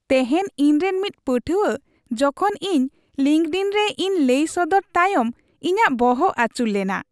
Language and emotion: Santali, happy